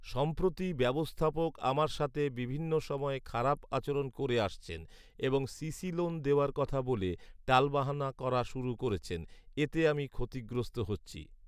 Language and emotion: Bengali, neutral